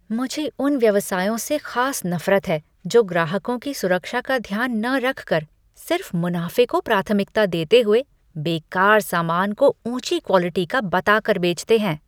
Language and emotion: Hindi, disgusted